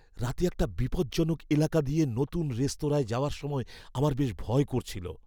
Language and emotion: Bengali, fearful